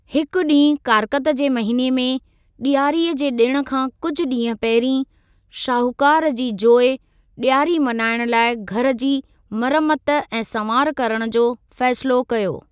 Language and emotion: Sindhi, neutral